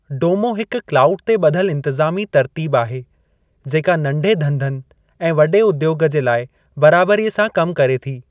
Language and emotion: Sindhi, neutral